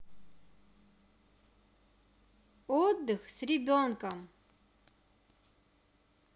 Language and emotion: Russian, positive